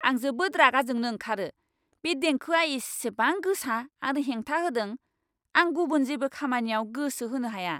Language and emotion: Bodo, angry